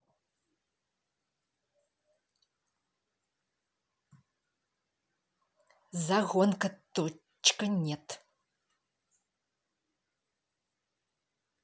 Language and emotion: Russian, angry